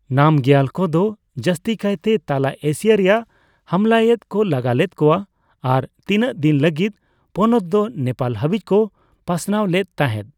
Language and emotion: Santali, neutral